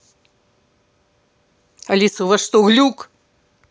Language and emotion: Russian, angry